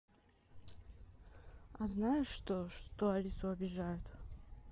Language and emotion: Russian, neutral